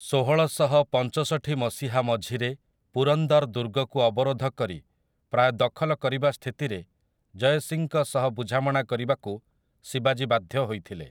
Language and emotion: Odia, neutral